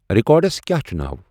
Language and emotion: Kashmiri, neutral